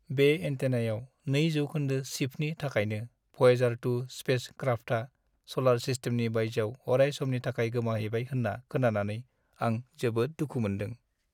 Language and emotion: Bodo, sad